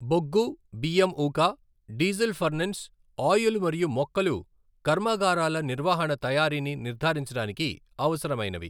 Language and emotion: Telugu, neutral